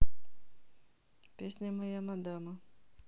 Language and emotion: Russian, neutral